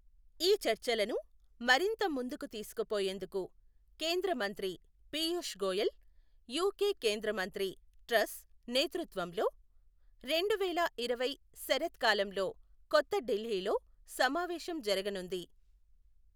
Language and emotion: Telugu, neutral